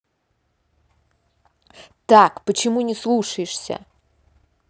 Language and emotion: Russian, angry